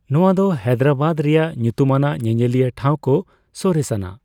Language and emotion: Santali, neutral